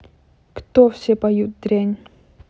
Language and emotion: Russian, neutral